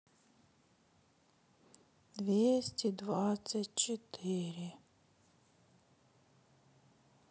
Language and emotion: Russian, sad